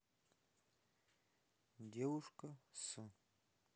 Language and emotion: Russian, neutral